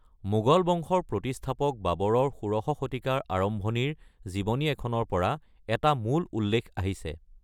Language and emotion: Assamese, neutral